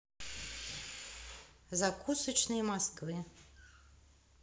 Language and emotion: Russian, neutral